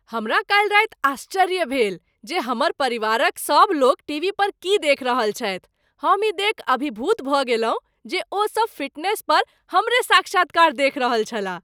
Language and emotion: Maithili, surprised